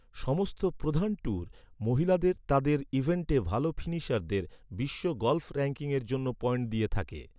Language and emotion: Bengali, neutral